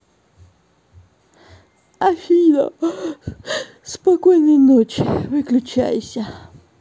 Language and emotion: Russian, neutral